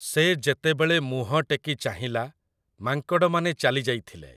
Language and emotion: Odia, neutral